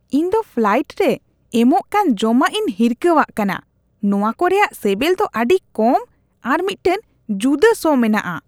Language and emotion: Santali, disgusted